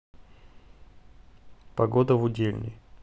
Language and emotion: Russian, neutral